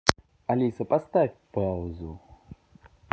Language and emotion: Russian, neutral